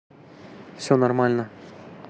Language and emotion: Russian, neutral